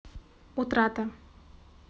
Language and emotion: Russian, neutral